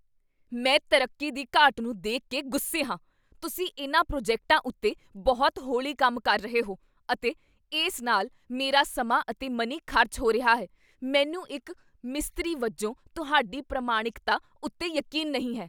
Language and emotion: Punjabi, angry